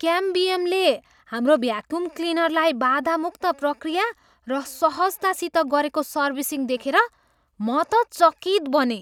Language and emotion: Nepali, surprised